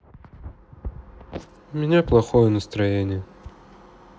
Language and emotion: Russian, sad